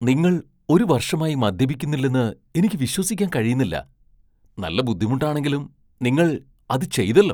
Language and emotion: Malayalam, surprised